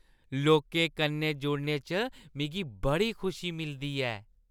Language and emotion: Dogri, happy